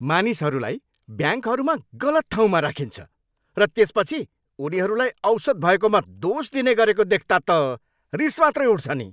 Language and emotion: Nepali, angry